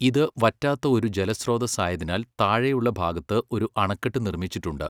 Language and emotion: Malayalam, neutral